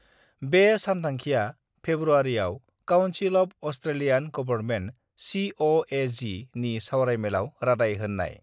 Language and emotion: Bodo, neutral